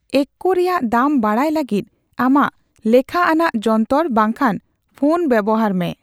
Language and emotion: Santali, neutral